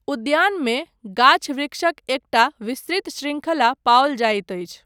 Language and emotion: Maithili, neutral